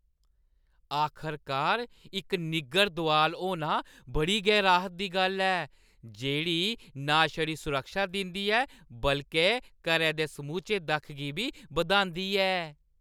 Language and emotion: Dogri, happy